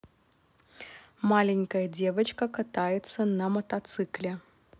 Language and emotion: Russian, neutral